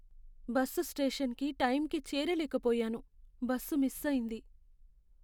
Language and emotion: Telugu, sad